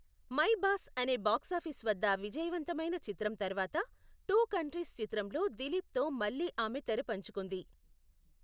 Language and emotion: Telugu, neutral